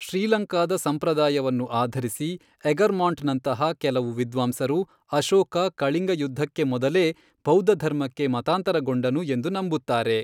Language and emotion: Kannada, neutral